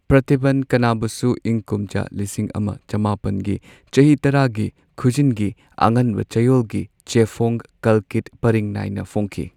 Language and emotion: Manipuri, neutral